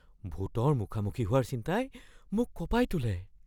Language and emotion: Assamese, fearful